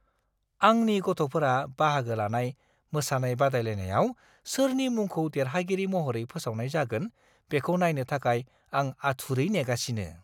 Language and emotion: Bodo, surprised